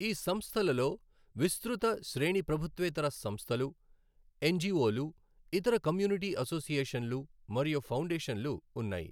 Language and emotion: Telugu, neutral